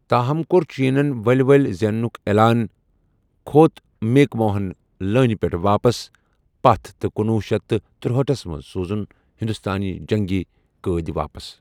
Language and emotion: Kashmiri, neutral